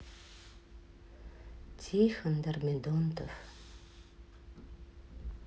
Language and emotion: Russian, sad